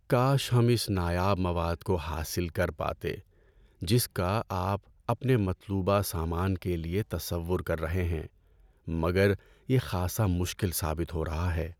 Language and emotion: Urdu, sad